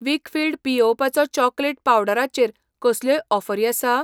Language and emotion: Goan Konkani, neutral